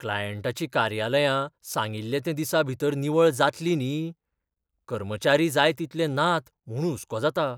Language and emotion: Goan Konkani, fearful